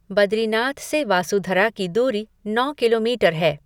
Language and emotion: Hindi, neutral